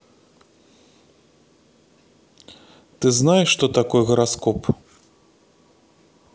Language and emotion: Russian, neutral